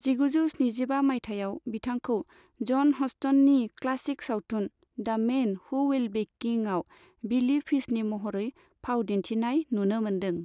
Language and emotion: Bodo, neutral